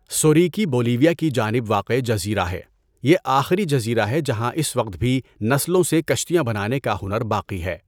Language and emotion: Urdu, neutral